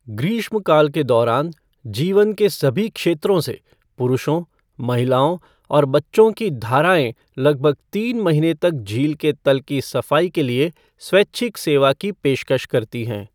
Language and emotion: Hindi, neutral